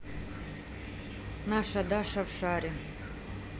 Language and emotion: Russian, neutral